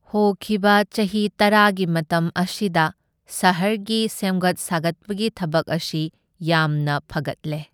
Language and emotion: Manipuri, neutral